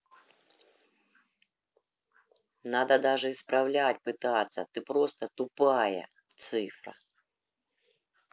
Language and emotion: Russian, angry